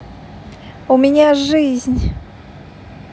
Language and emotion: Russian, positive